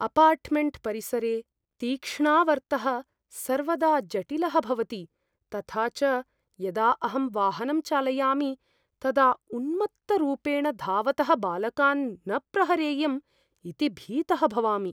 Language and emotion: Sanskrit, fearful